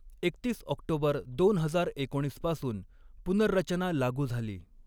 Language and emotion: Marathi, neutral